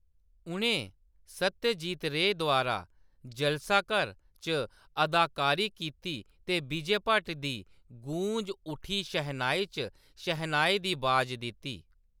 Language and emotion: Dogri, neutral